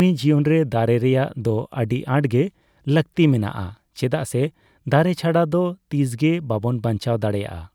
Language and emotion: Santali, neutral